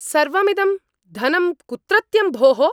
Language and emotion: Sanskrit, angry